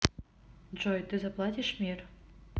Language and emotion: Russian, neutral